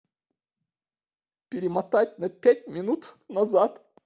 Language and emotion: Russian, sad